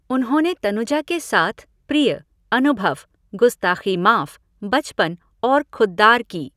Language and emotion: Hindi, neutral